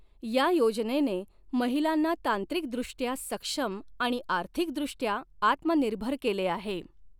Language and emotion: Marathi, neutral